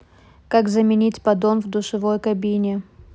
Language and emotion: Russian, neutral